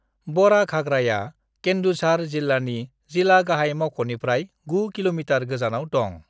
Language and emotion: Bodo, neutral